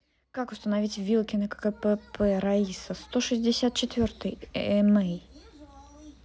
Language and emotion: Russian, neutral